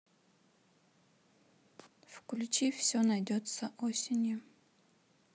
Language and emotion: Russian, neutral